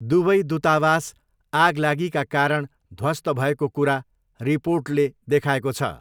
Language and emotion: Nepali, neutral